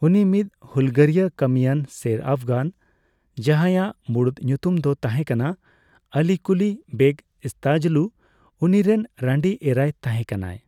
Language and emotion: Santali, neutral